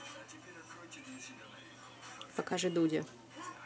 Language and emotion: Russian, neutral